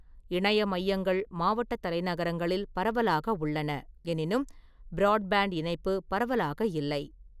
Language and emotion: Tamil, neutral